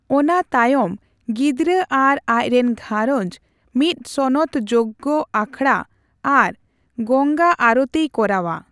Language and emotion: Santali, neutral